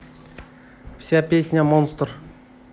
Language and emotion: Russian, neutral